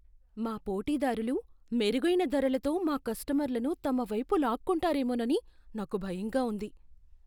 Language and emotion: Telugu, fearful